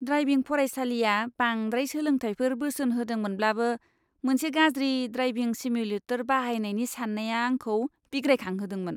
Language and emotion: Bodo, disgusted